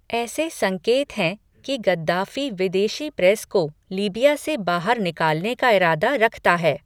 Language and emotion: Hindi, neutral